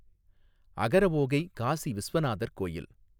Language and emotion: Tamil, neutral